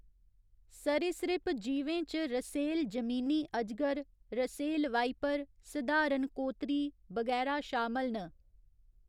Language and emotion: Dogri, neutral